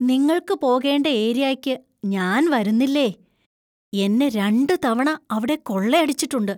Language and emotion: Malayalam, fearful